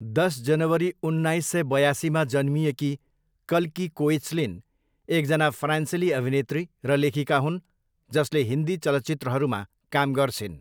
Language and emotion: Nepali, neutral